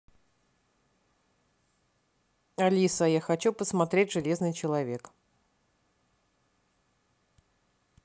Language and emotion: Russian, neutral